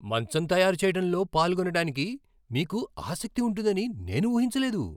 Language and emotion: Telugu, surprised